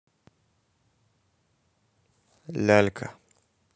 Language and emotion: Russian, neutral